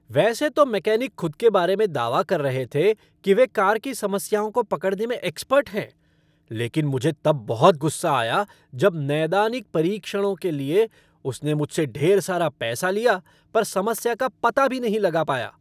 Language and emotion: Hindi, angry